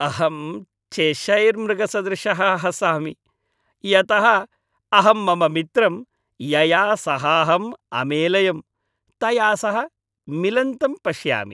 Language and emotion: Sanskrit, happy